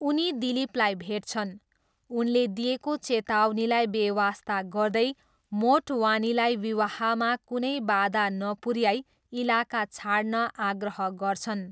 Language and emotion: Nepali, neutral